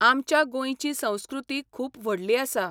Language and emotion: Goan Konkani, neutral